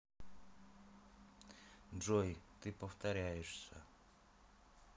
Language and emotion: Russian, neutral